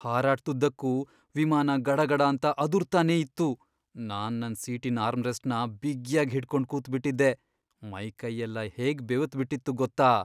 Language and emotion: Kannada, fearful